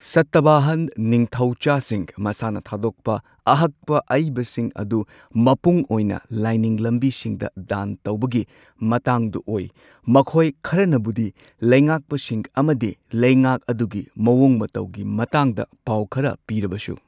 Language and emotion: Manipuri, neutral